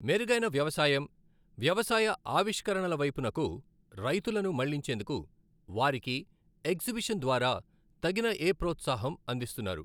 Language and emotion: Telugu, neutral